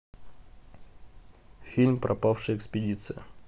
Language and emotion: Russian, neutral